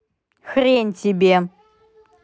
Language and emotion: Russian, angry